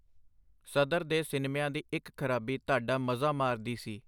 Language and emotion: Punjabi, neutral